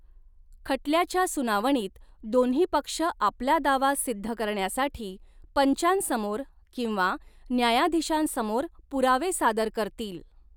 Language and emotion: Marathi, neutral